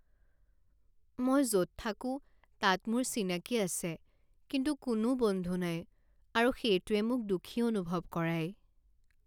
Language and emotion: Assamese, sad